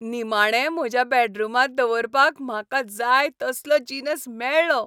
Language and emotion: Goan Konkani, happy